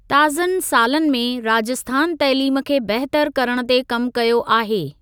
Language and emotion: Sindhi, neutral